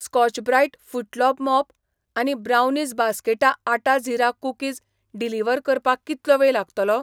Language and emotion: Goan Konkani, neutral